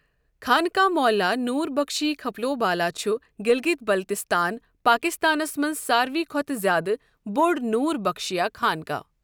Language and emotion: Kashmiri, neutral